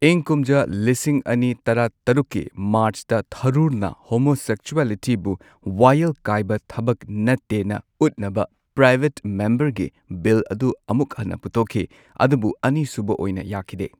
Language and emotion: Manipuri, neutral